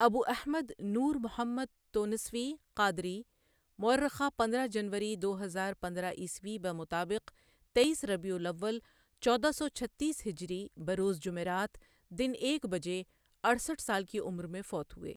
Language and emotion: Urdu, neutral